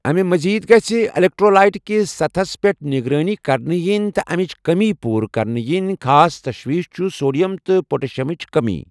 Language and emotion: Kashmiri, neutral